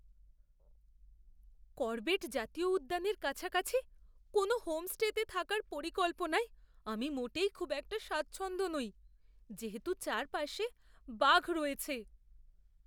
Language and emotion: Bengali, fearful